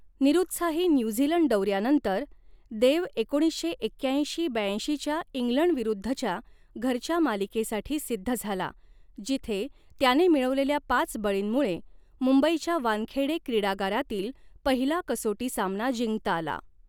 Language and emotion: Marathi, neutral